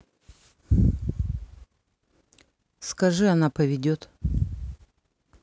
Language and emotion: Russian, neutral